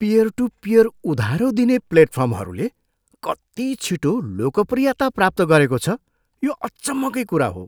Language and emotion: Nepali, surprised